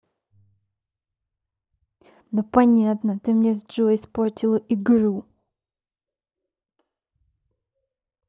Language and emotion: Russian, angry